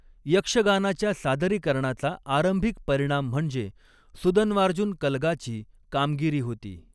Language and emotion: Marathi, neutral